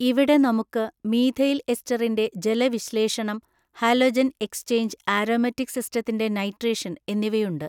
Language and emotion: Malayalam, neutral